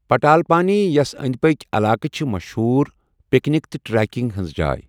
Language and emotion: Kashmiri, neutral